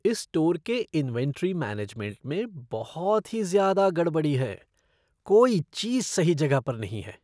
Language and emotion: Hindi, disgusted